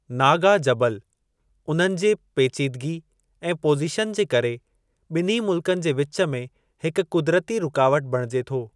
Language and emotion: Sindhi, neutral